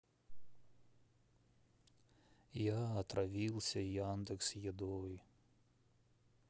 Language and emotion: Russian, sad